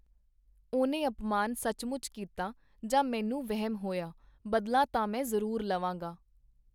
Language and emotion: Punjabi, neutral